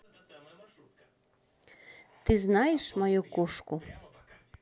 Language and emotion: Russian, neutral